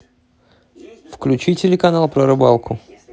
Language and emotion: Russian, neutral